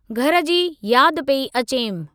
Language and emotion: Sindhi, neutral